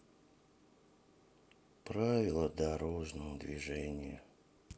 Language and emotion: Russian, sad